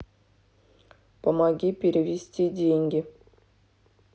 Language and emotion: Russian, neutral